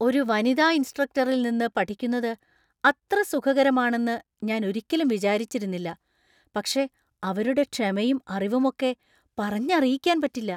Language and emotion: Malayalam, surprised